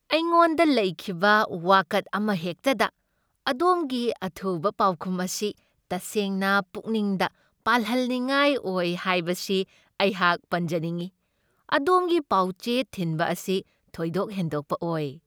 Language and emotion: Manipuri, happy